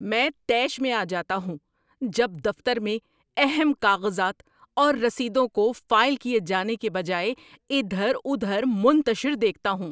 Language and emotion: Urdu, angry